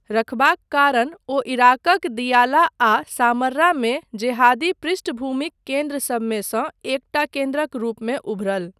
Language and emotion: Maithili, neutral